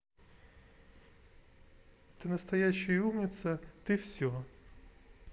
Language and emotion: Russian, positive